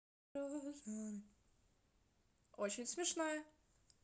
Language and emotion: Russian, positive